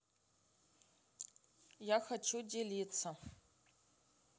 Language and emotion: Russian, neutral